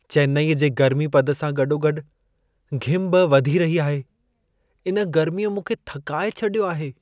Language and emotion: Sindhi, sad